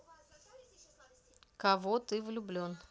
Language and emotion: Russian, neutral